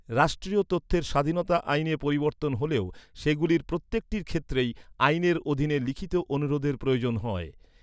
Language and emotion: Bengali, neutral